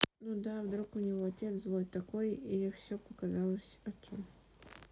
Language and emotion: Russian, neutral